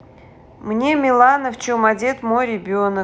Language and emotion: Russian, neutral